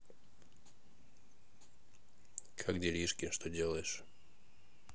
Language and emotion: Russian, neutral